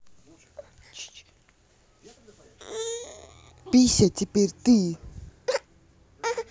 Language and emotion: Russian, angry